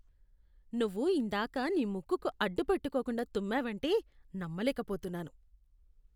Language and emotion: Telugu, disgusted